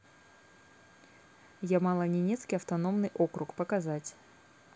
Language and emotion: Russian, neutral